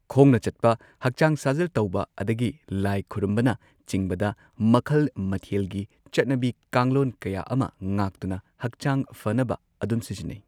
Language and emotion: Manipuri, neutral